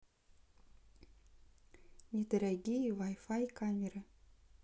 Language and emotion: Russian, neutral